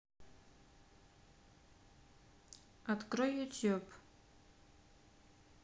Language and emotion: Russian, neutral